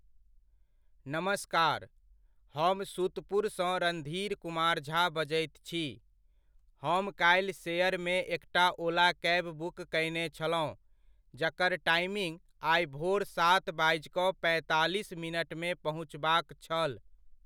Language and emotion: Maithili, neutral